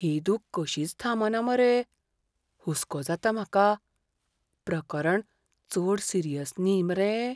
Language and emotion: Goan Konkani, fearful